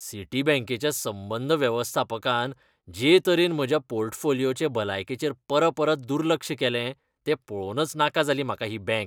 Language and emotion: Goan Konkani, disgusted